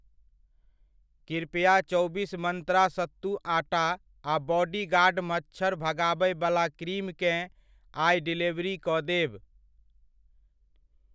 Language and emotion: Maithili, neutral